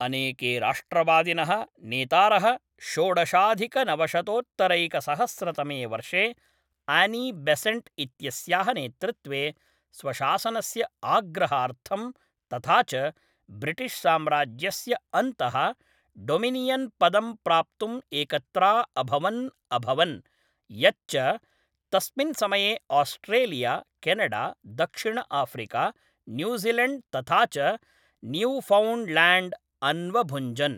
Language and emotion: Sanskrit, neutral